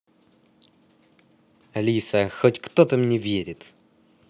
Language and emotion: Russian, positive